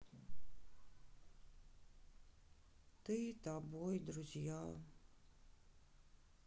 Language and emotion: Russian, sad